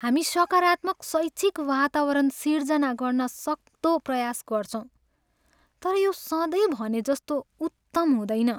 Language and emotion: Nepali, sad